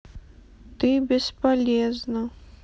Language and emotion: Russian, sad